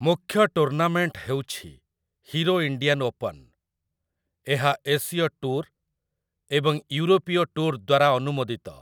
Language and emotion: Odia, neutral